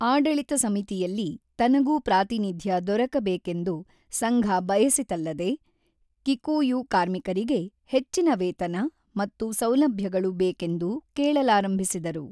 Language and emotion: Kannada, neutral